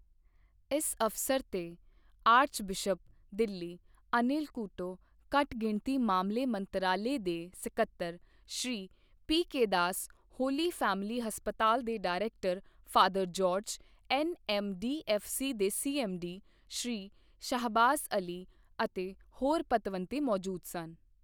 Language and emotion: Punjabi, neutral